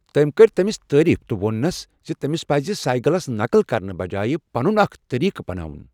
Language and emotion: Kashmiri, neutral